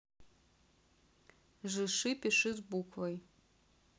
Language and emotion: Russian, neutral